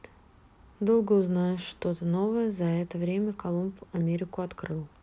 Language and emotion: Russian, neutral